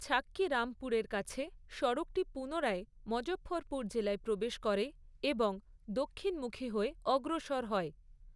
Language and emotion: Bengali, neutral